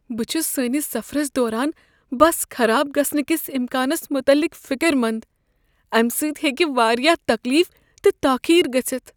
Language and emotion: Kashmiri, fearful